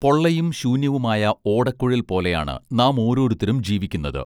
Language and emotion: Malayalam, neutral